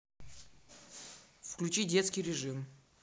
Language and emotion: Russian, neutral